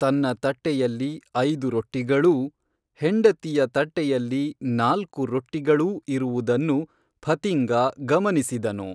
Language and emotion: Kannada, neutral